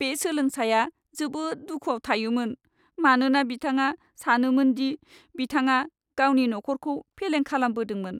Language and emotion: Bodo, sad